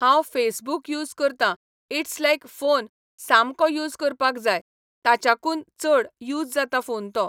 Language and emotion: Goan Konkani, neutral